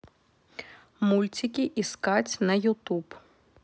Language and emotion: Russian, neutral